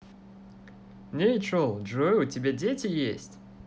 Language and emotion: Russian, positive